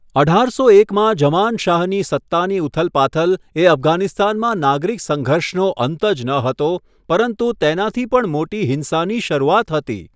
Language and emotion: Gujarati, neutral